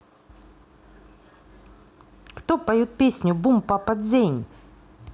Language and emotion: Russian, neutral